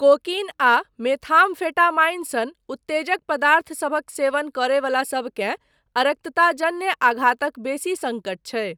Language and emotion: Maithili, neutral